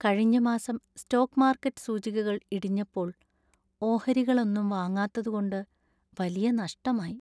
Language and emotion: Malayalam, sad